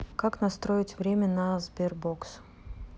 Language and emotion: Russian, neutral